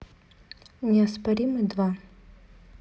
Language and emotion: Russian, neutral